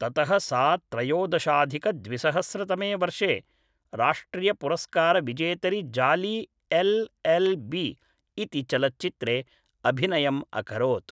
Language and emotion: Sanskrit, neutral